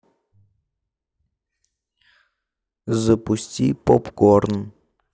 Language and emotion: Russian, neutral